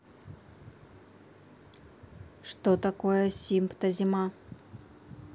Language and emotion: Russian, neutral